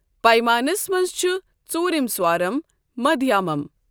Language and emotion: Kashmiri, neutral